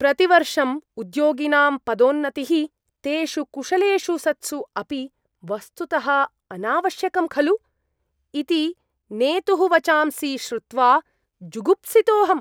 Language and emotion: Sanskrit, disgusted